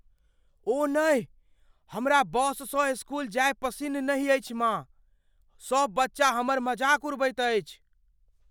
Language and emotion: Maithili, fearful